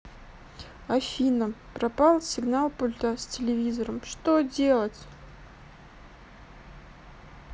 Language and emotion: Russian, sad